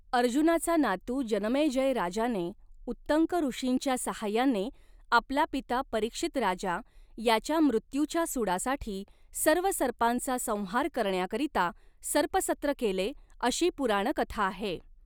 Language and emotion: Marathi, neutral